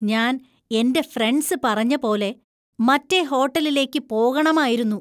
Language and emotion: Malayalam, disgusted